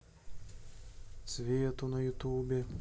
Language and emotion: Russian, neutral